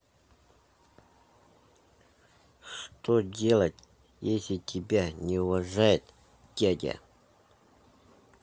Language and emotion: Russian, neutral